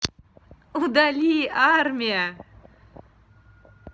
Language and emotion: Russian, positive